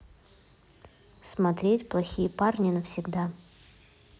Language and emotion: Russian, neutral